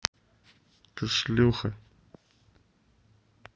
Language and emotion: Russian, angry